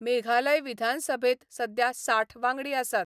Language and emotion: Goan Konkani, neutral